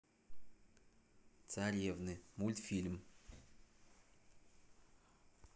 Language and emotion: Russian, neutral